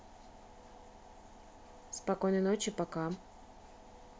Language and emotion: Russian, neutral